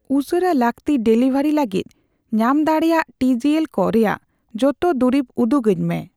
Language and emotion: Santali, neutral